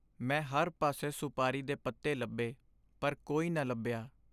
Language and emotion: Punjabi, sad